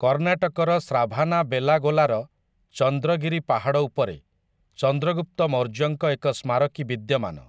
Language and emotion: Odia, neutral